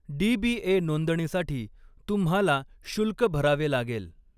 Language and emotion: Marathi, neutral